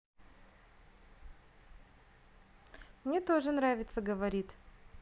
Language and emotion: Russian, positive